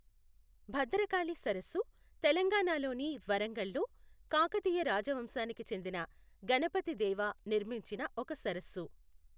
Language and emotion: Telugu, neutral